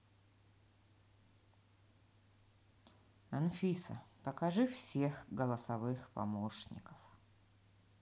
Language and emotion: Russian, neutral